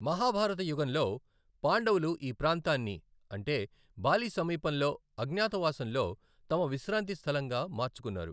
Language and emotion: Telugu, neutral